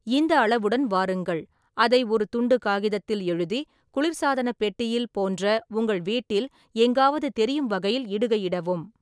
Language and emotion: Tamil, neutral